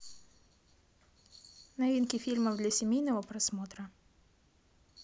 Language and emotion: Russian, neutral